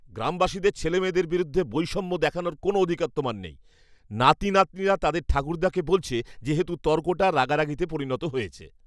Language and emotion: Bengali, angry